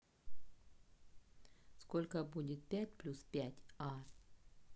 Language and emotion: Russian, neutral